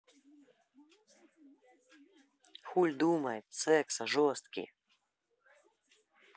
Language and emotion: Russian, angry